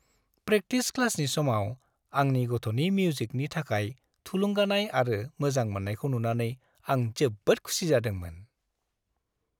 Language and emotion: Bodo, happy